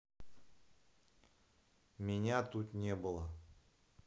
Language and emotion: Russian, neutral